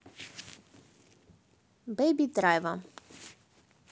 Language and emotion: Russian, neutral